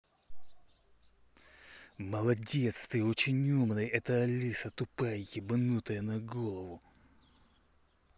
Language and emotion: Russian, angry